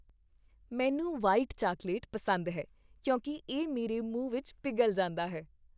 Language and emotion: Punjabi, happy